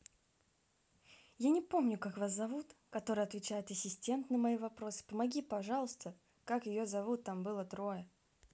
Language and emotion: Russian, neutral